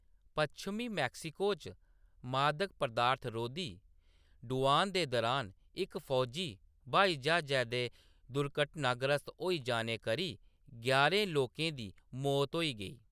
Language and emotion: Dogri, neutral